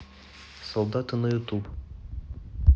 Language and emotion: Russian, neutral